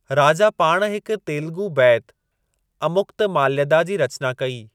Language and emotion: Sindhi, neutral